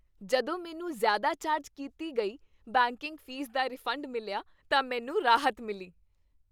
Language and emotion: Punjabi, happy